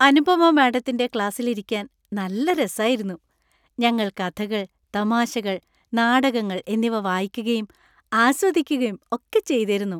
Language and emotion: Malayalam, happy